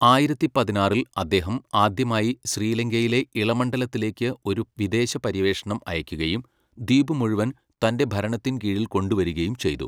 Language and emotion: Malayalam, neutral